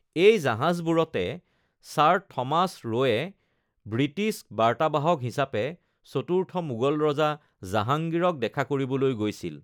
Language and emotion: Assamese, neutral